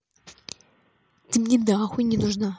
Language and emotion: Russian, angry